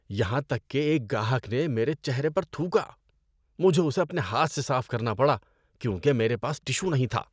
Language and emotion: Urdu, disgusted